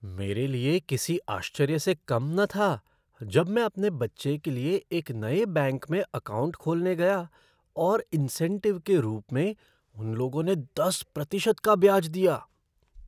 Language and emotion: Hindi, surprised